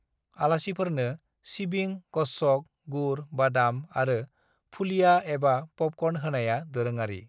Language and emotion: Bodo, neutral